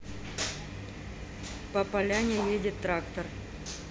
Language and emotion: Russian, neutral